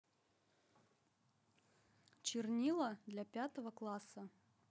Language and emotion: Russian, neutral